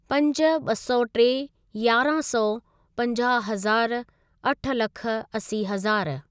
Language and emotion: Sindhi, neutral